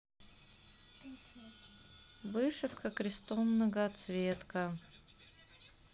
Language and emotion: Russian, neutral